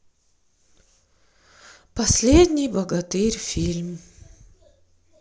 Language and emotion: Russian, sad